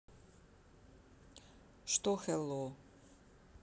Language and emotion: Russian, neutral